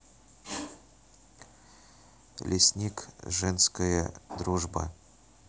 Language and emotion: Russian, neutral